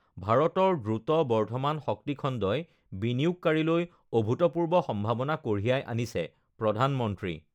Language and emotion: Assamese, neutral